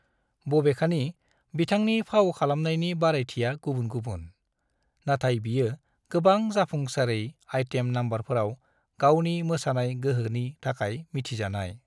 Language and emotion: Bodo, neutral